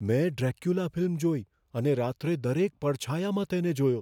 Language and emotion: Gujarati, fearful